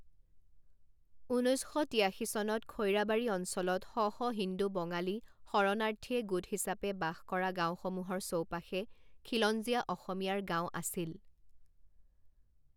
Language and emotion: Assamese, neutral